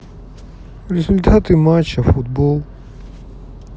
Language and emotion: Russian, sad